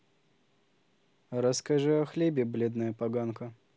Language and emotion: Russian, neutral